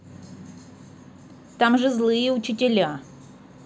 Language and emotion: Russian, neutral